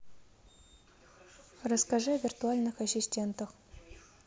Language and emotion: Russian, neutral